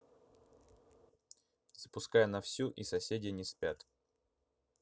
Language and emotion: Russian, neutral